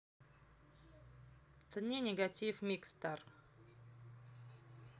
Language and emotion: Russian, neutral